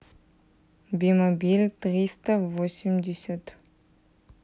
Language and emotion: Russian, neutral